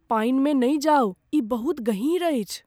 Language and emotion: Maithili, fearful